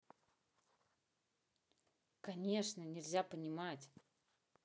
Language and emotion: Russian, neutral